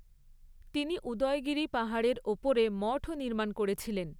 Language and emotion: Bengali, neutral